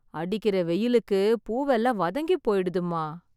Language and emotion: Tamil, sad